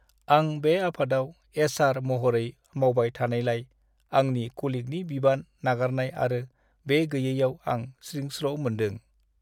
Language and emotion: Bodo, sad